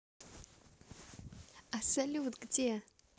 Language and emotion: Russian, positive